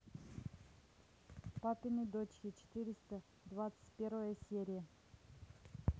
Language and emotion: Russian, neutral